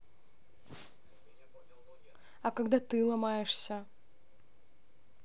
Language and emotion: Russian, neutral